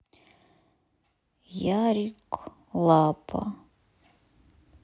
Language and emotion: Russian, sad